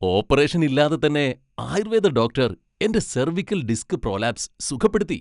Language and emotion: Malayalam, happy